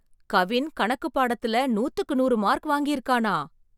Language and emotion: Tamil, surprised